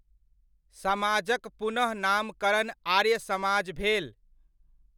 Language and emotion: Maithili, neutral